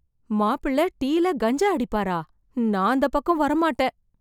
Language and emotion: Tamil, fearful